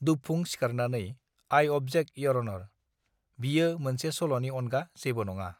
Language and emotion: Bodo, neutral